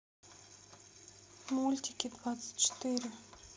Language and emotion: Russian, neutral